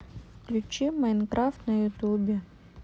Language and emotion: Russian, neutral